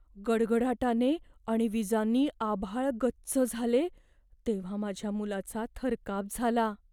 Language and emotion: Marathi, fearful